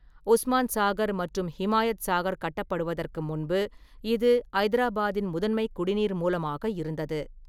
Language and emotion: Tamil, neutral